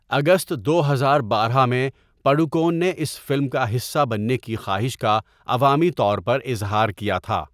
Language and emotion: Urdu, neutral